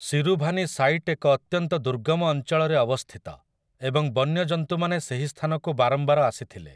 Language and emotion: Odia, neutral